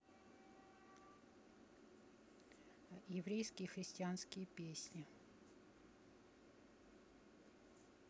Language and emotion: Russian, neutral